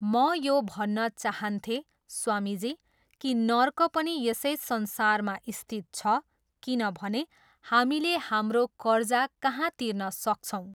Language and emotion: Nepali, neutral